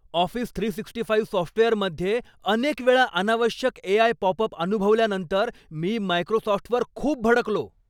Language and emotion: Marathi, angry